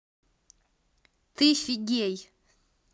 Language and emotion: Russian, neutral